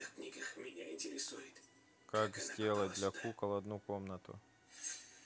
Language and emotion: Russian, neutral